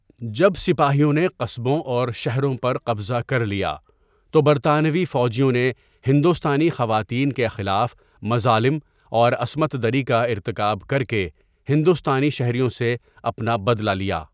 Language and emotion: Urdu, neutral